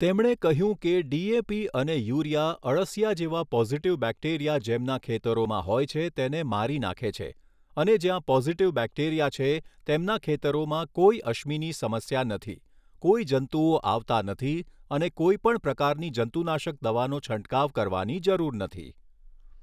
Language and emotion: Gujarati, neutral